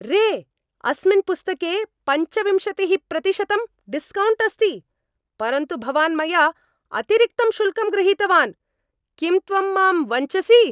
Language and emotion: Sanskrit, angry